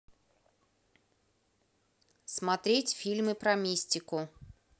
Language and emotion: Russian, neutral